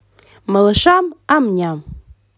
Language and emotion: Russian, positive